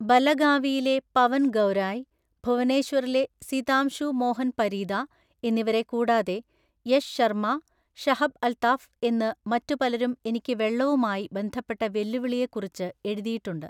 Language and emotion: Malayalam, neutral